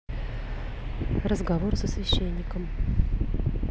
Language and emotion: Russian, neutral